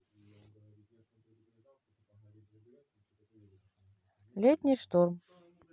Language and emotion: Russian, neutral